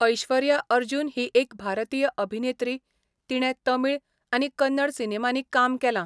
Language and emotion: Goan Konkani, neutral